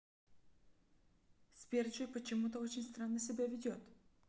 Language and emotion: Russian, neutral